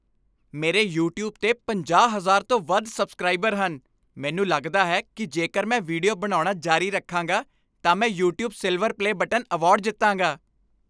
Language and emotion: Punjabi, happy